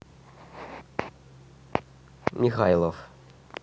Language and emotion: Russian, neutral